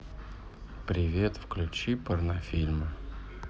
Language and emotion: Russian, neutral